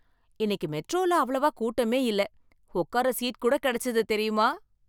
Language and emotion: Tamil, happy